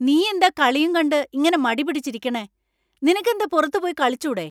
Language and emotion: Malayalam, angry